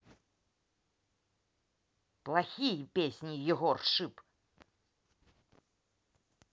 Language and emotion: Russian, angry